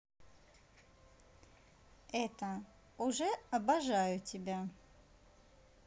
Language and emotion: Russian, positive